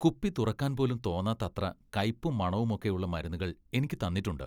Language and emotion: Malayalam, disgusted